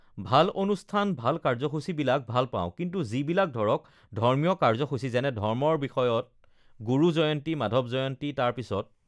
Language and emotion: Assamese, neutral